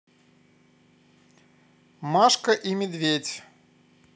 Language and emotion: Russian, positive